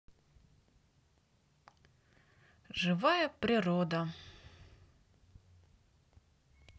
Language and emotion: Russian, positive